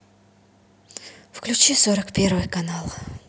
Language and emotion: Russian, neutral